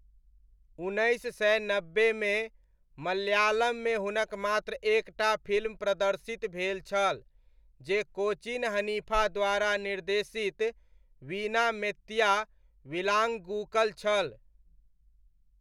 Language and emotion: Maithili, neutral